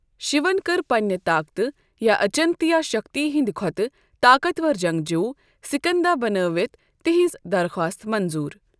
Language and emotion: Kashmiri, neutral